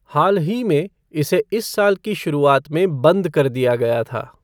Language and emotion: Hindi, neutral